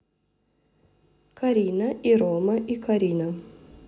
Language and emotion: Russian, neutral